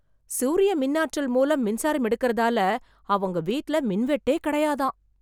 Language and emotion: Tamil, surprised